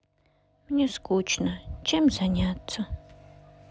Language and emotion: Russian, sad